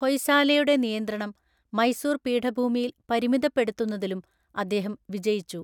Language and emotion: Malayalam, neutral